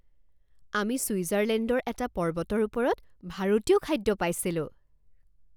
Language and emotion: Assamese, surprised